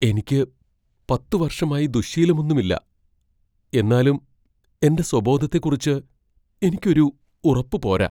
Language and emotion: Malayalam, fearful